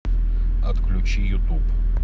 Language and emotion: Russian, neutral